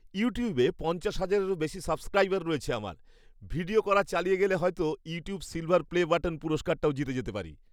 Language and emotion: Bengali, happy